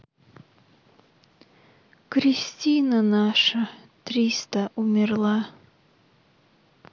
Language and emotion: Russian, sad